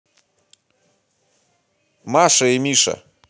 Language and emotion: Russian, neutral